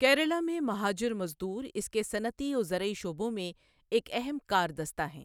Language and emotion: Urdu, neutral